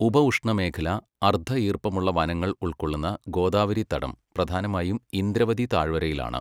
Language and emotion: Malayalam, neutral